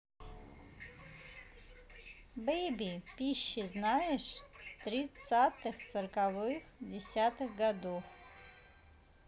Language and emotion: Russian, neutral